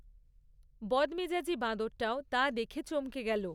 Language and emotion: Bengali, neutral